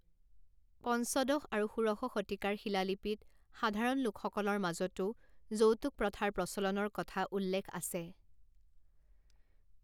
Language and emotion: Assamese, neutral